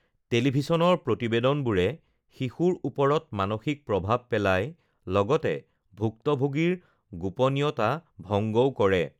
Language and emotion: Assamese, neutral